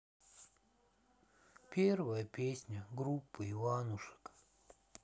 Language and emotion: Russian, sad